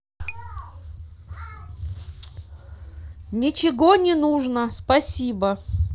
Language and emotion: Russian, neutral